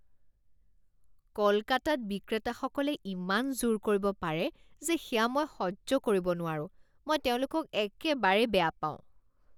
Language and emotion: Assamese, disgusted